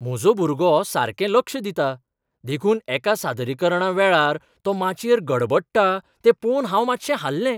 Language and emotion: Goan Konkani, surprised